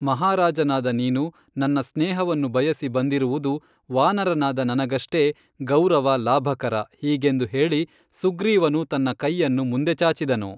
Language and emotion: Kannada, neutral